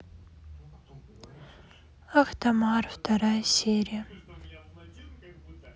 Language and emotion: Russian, sad